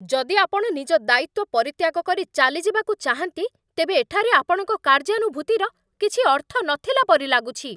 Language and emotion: Odia, angry